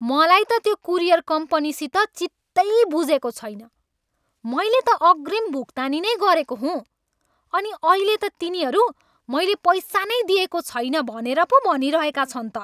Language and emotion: Nepali, angry